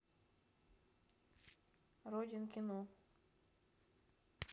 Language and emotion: Russian, neutral